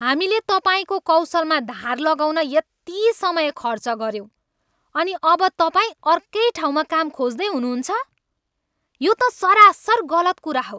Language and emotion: Nepali, angry